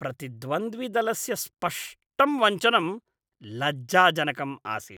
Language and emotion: Sanskrit, disgusted